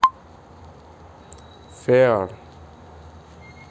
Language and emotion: Russian, neutral